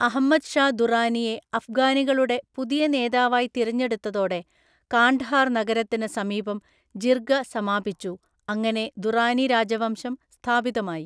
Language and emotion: Malayalam, neutral